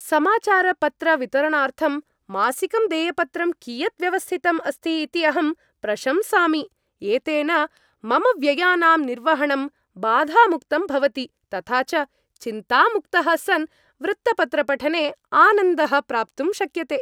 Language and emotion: Sanskrit, happy